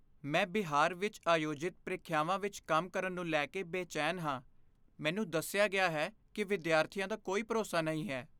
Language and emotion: Punjabi, fearful